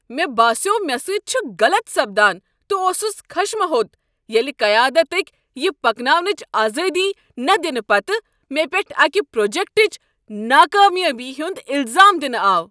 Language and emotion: Kashmiri, angry